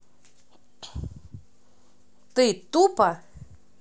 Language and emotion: Russian, angry